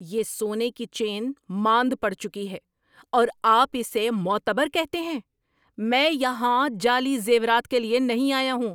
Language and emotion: Urdu, angry